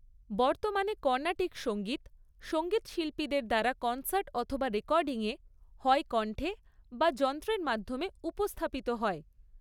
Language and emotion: Bengali, neutral